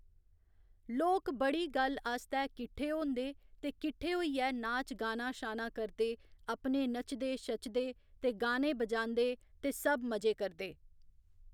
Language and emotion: Dogri, neutral